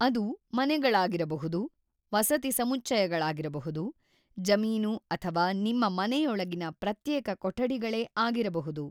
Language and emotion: Kannada, neutral